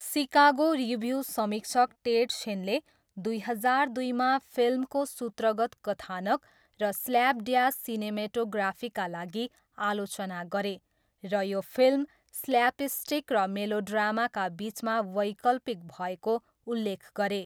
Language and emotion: Nepali, neutral